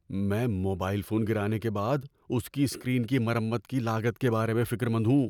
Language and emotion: Urdu, fearful